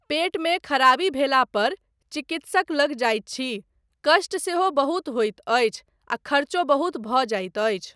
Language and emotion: Maithili, neutral